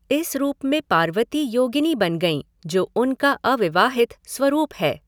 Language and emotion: Hindi, neutral